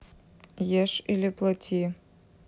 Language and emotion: Russian, neutral